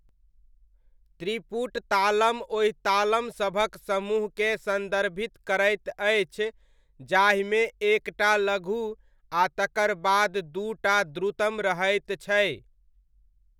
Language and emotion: Maithili, neutral